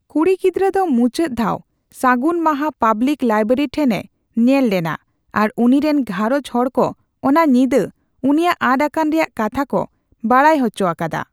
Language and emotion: Santali, neutral